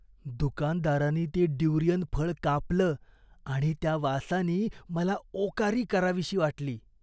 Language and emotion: Marathi, disgusted